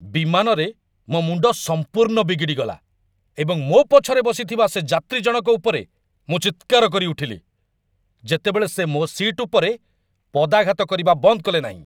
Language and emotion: Odia, angry